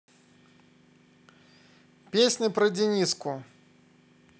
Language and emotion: Russian, positive